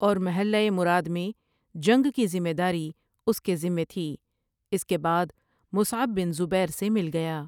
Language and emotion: Urdu, neutral